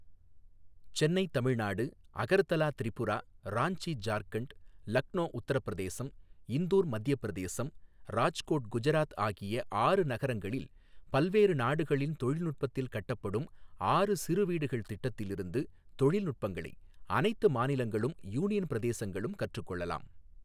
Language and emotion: Tamil, neutral